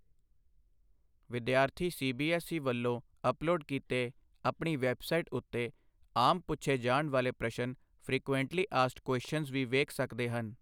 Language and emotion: Punjabi, neutral